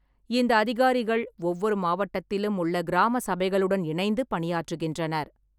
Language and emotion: Tamil, neutral